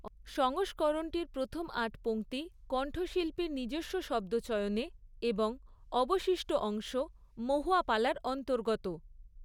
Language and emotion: Bengali, neutral